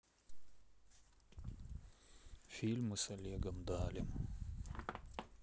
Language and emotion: Russian, sad